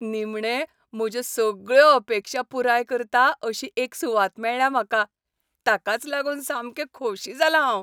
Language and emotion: Goan Konkani, happy